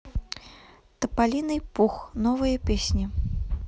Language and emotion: Russian, neutral